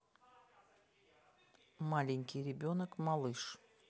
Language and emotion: Russian, neutral